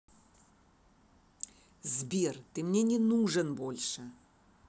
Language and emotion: Russian, angry